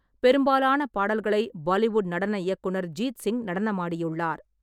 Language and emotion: Tamil, neutral